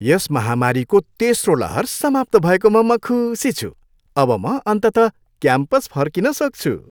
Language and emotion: Nepali, happy